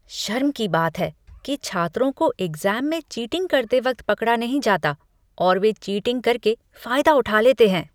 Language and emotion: Hindi, disgusted